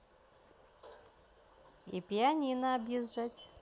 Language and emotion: Russian, neutral